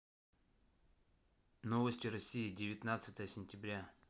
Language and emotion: Russian, neutral